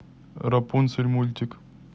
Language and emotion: Russian, neutral